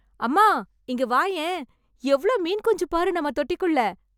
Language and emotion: Tamil, surprised